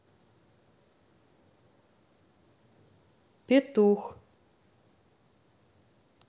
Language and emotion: Russian, neutral